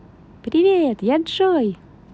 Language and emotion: Russian, positive